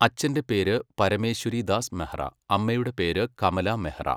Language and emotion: Malayalam, neutral